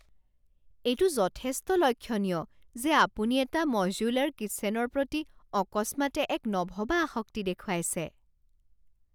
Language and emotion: Assamese, surprised